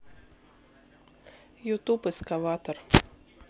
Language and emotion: Russian, neutral